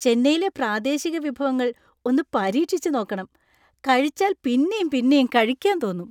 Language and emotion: Malayalam, happy